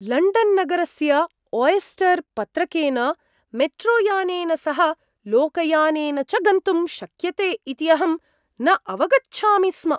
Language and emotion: Sanskrit, surprised